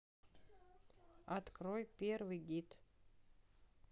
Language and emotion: Russian, neutral